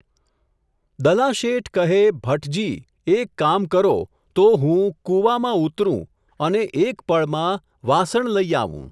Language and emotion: Gujarati, neutral